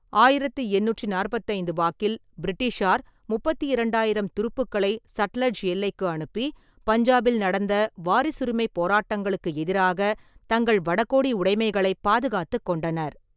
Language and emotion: Tamil, neutral